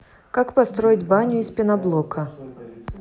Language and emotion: Russian, neutral